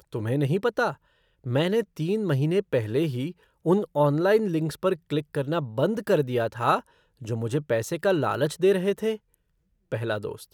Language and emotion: Hindi, surprised